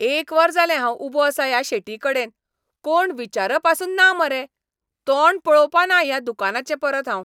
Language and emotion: Goan Konkani, angry